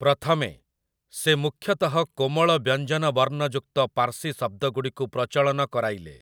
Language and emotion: Odia, neutral